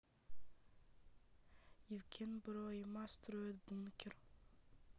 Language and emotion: Russian, sad